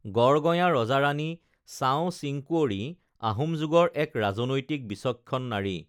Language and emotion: Assamese, neutral